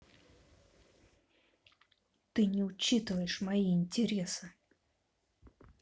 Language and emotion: Russian, angry